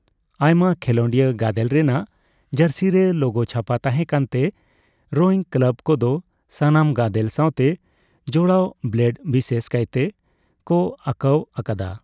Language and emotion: Santali, neutral